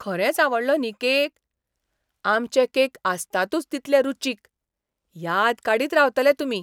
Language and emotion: Goan Konkani, surprised